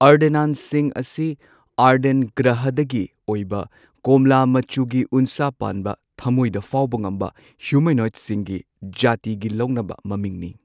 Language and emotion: Manipuri, neutral